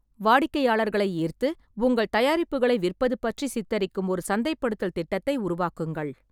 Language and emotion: Tamil, neutral